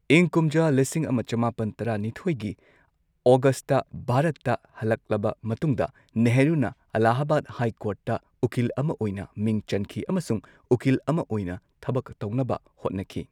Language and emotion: Manipuri, neutral